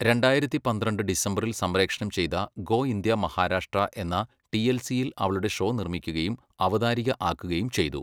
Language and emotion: Malayalam, neutral